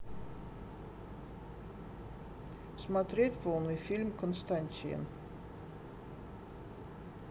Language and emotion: Russian, neutral